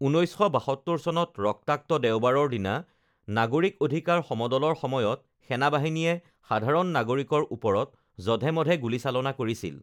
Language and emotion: Assamese, neutral